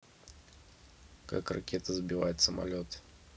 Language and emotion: Russian, neutral